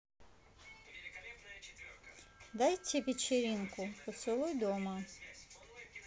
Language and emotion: Russian, neutral